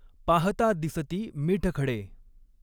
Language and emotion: Marathi, neutral